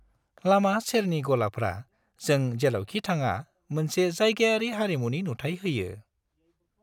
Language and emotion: Bodo, happy